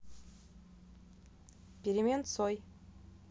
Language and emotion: Russian, neutral